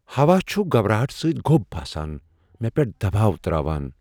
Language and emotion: Kashmiri, fearful